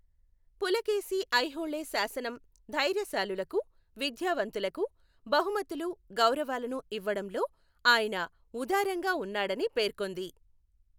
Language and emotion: Telugu, neutral